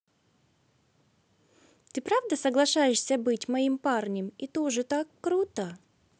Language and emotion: Russian, positive